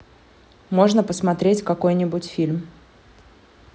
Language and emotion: Russian, neutral